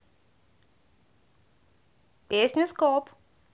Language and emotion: Russian, positive